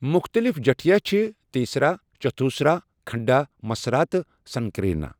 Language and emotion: Kashmiri, neutral